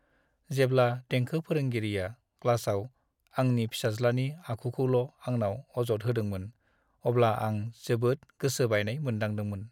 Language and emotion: Bodo, sad